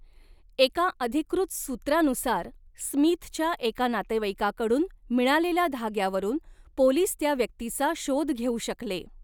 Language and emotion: Marathi, neutral